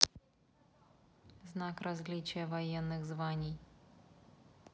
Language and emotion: Russian, neutral